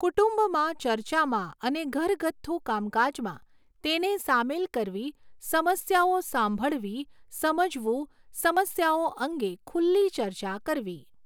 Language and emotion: Gujarati, neutral